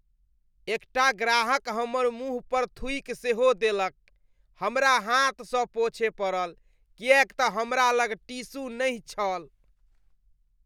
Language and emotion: Maithili, disgusted